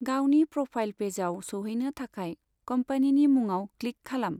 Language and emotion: Bodo, neutral